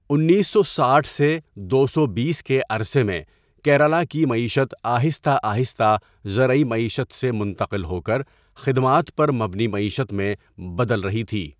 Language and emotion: Urdu, neutral